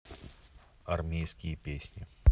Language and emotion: Russian, neutral